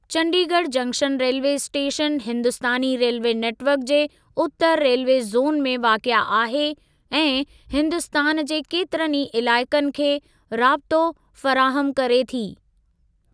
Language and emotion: Sindhi, neutral